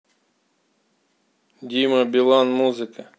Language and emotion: Russian, neutral